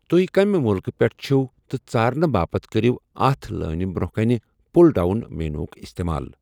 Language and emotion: Kashmiri, neutral